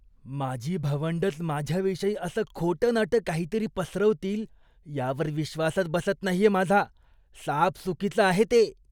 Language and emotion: Marathi, disgusted